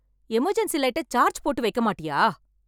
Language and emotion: Tamil, angry